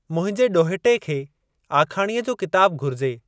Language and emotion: Sindhi, neutral